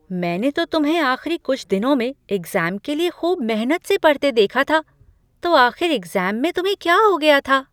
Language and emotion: Hindi, surprised